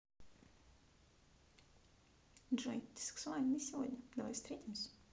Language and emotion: Russian, positive